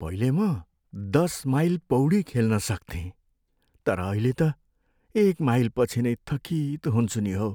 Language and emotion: Nepali, sad